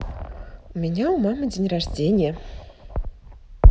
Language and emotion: Russian, positive